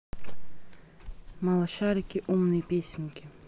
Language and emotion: Russian, neutral